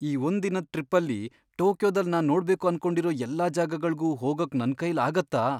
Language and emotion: Kannada, fearful